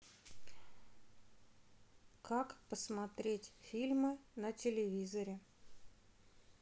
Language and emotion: Russian, neutral